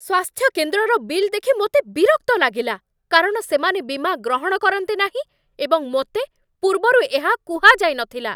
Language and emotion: Odia, angry